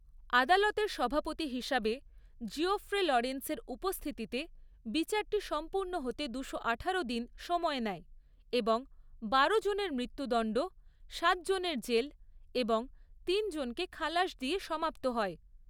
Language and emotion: Bengali, neutral